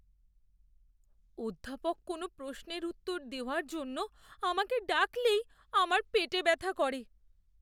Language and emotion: Bengali, fearful